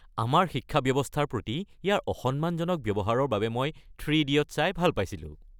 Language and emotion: Assamese, happy